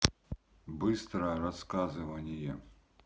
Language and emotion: Russian, neutral